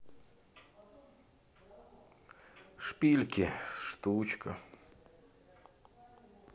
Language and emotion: Russian, sad